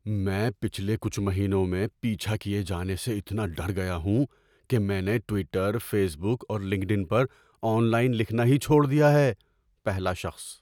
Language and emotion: Urdu, fearful